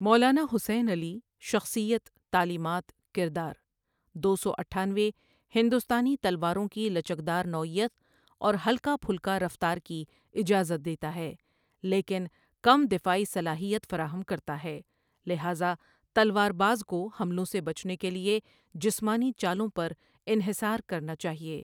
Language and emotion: Urdu, neutral